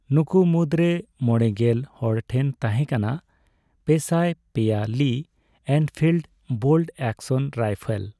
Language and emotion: Santali, neutral